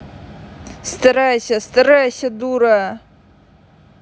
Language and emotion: Russian, angry